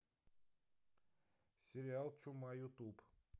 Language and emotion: Russian, neutral